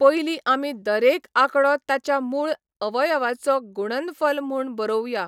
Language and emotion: Goan Konkani, neutral